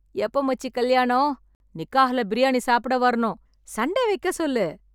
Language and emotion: Tamil, happy